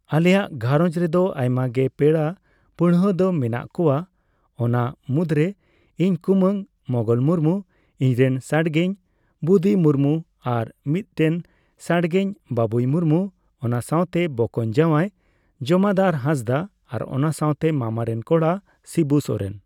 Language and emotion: Santali, neutral